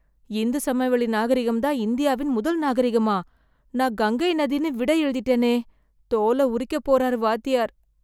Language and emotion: Tamil, fearful